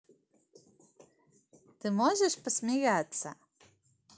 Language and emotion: Russian, positive